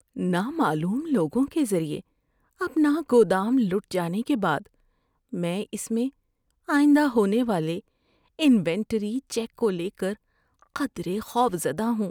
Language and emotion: Urdu, fearful